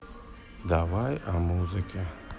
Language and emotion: Russian, neutral